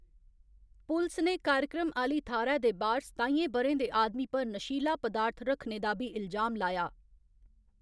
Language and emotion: Dogri, neutral